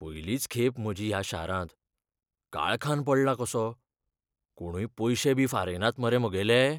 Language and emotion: Goan Konkani, fearful